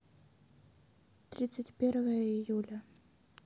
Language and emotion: Russian, sad